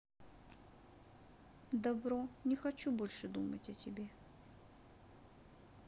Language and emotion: Russian, sad